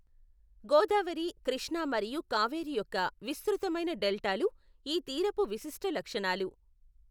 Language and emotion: Telugu, neutral